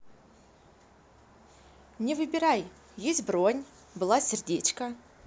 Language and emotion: Russian, positive